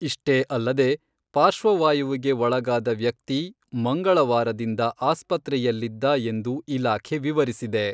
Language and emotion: Kannada, neutral